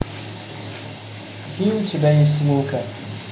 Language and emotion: Russian, neutral